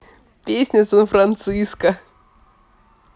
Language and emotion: Russian, positive